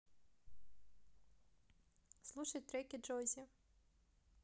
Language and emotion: Russian, neutral